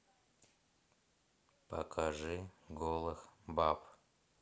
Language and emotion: Russian, sad